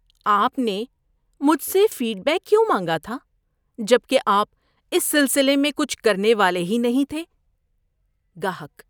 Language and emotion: Urdu, disgusted